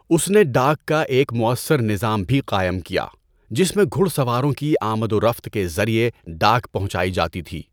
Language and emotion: Urdu, neutral